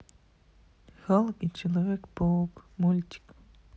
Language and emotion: Russian, sad